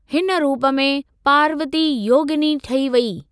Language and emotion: Sindhi, neutral